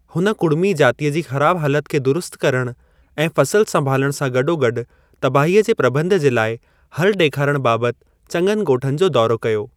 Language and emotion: Sindhi, neutral